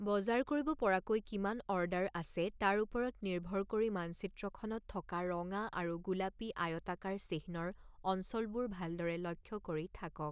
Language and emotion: Assamese, neutral